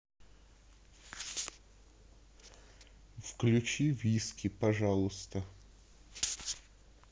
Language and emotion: Russian, neutral